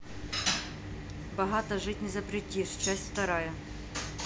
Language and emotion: Russian, neutral